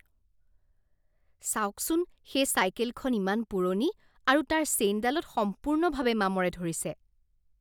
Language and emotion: Assamese, disgusted